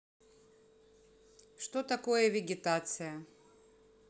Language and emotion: Russian, neutral